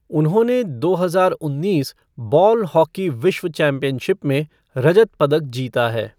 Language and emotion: Hindi, neutral